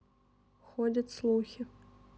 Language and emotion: Russian, neutral